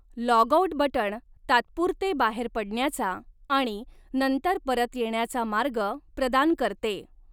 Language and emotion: Marathi, neutral